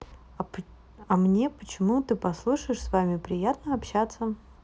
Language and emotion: Russian, neutral